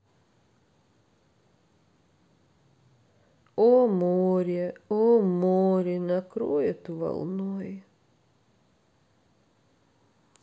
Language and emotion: Russian, sad